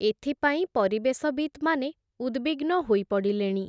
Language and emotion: Odia, neutral